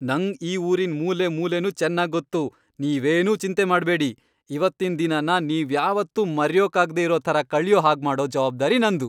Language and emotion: Kannada, happy